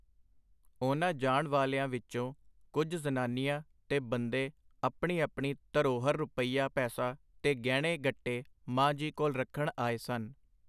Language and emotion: Punjabi, neutral